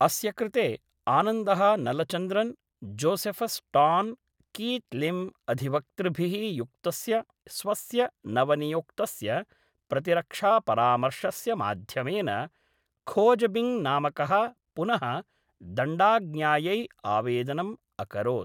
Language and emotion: Sanskrit, neutral